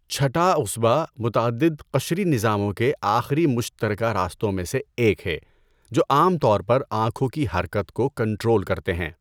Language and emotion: Urdu, neutral